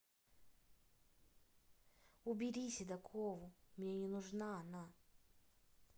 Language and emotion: Russian, neutral